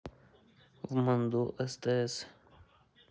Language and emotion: Russian, neutral